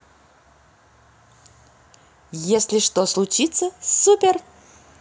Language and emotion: Russian, positive